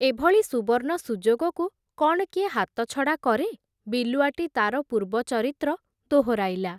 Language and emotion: Odia, neutral